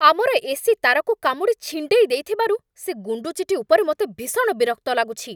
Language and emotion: Odia, angry